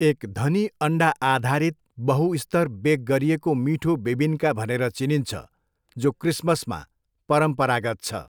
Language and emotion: Nepali, neutral